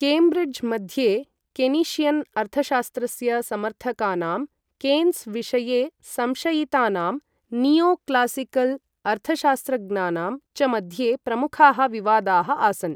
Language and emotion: Sanskrit, neutral